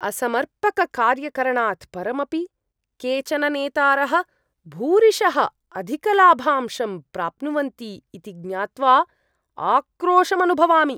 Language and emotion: Sanskrit, disgusted